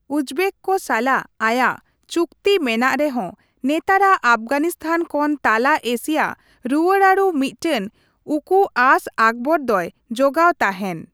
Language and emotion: Santali, neutral